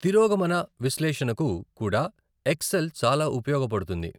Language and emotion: Telugu, neutral